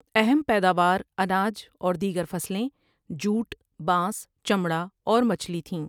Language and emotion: Urdu, neutral